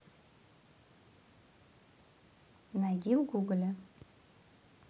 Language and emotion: Russian, neutral